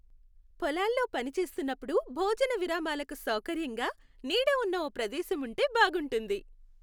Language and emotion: Telugu, happy